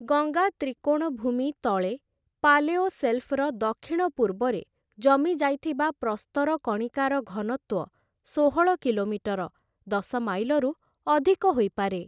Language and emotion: Odia, neutral